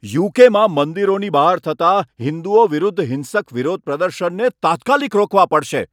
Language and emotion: Gujarati, angry